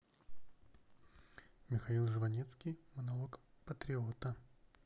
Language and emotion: Russian, neutral